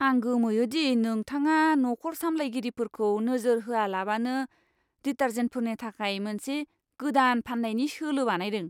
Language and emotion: Bodo, disgusted